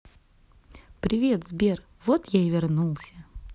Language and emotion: Russian, positive